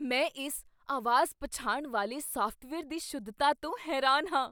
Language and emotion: Punjabi, surprised